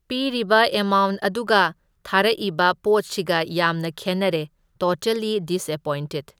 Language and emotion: Manipuri, neutral